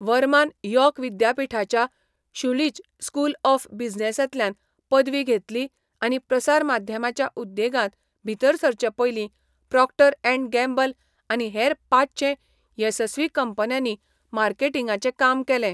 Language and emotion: Goan Konkani, neutral